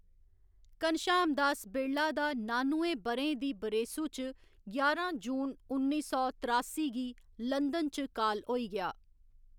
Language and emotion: Dogri, neutral